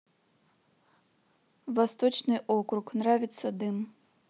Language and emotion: Russian, neutral